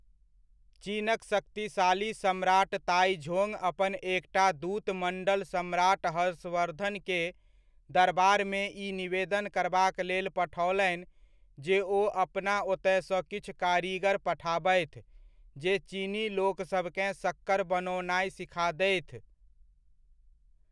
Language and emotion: Maithili, neutral